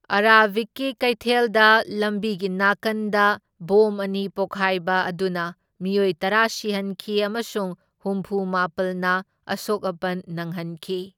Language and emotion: Manipuri, neutral